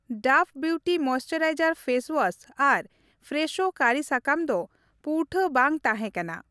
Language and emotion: Santali, neutral